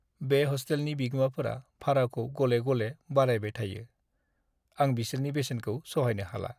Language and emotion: Bodo, sad